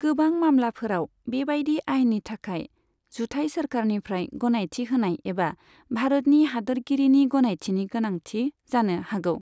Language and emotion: Bodo, neutral